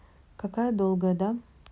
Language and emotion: Russian, neutral